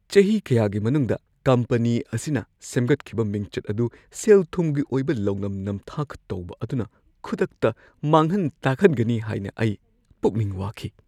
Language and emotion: Manipuri, fearful